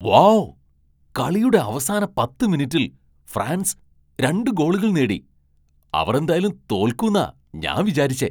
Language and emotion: Malayalam, surprised